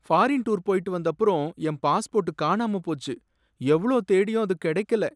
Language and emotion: Tamil, sad